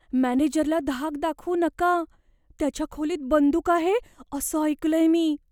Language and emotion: Marathi, fearful